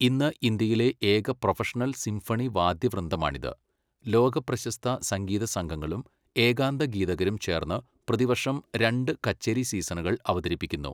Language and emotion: Malayalam, neutral